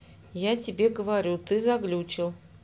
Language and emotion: Russian, neutral